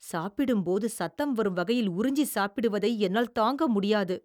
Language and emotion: Tamil, disgusted